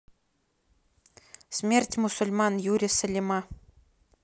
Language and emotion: Russian, neutral